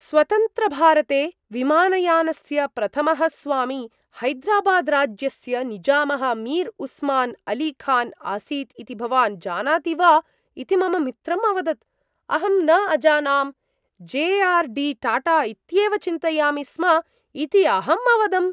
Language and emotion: Sanskrit, surprised